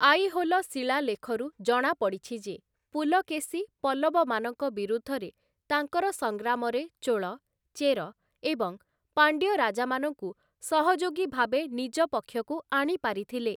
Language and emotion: Odia, neutral